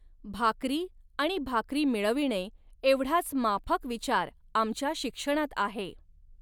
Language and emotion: Marathi, neutral